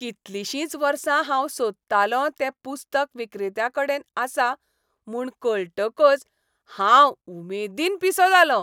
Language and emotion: Goan Konkani, happy